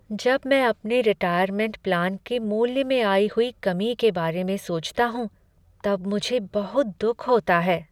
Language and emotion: Hindi, sad